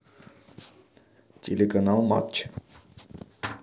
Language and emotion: Russian, neutral